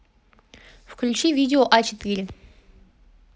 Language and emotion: Russian, neutral